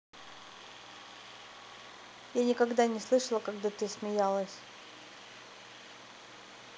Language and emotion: Russian, neutral